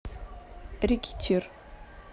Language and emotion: Russian, neutral